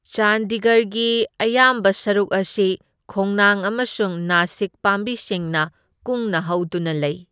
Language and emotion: Manipuri, neutral